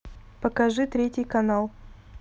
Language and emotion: Russian, neutral